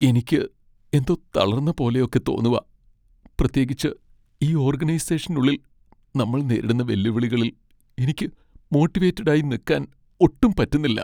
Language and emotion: Malayalam, sad